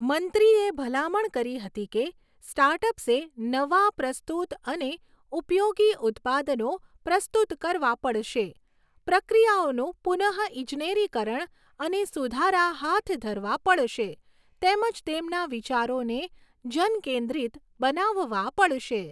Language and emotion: Gujarati, neutral